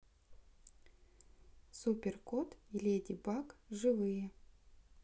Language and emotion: Russian, neutral